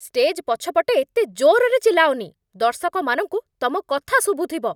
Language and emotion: Odia, angry